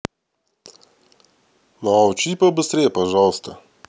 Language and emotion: Russian, neutral